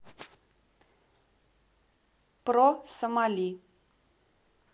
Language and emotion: Russian, neutral